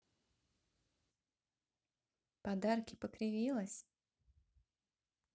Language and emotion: Russian, neutral